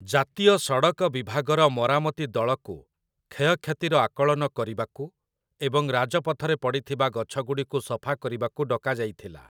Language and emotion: Odia, neutral